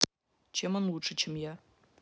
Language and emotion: Russian, neutral